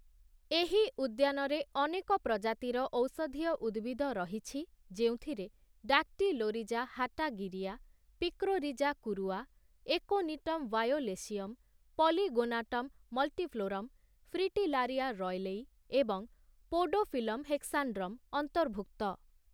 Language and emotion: Odia, neutral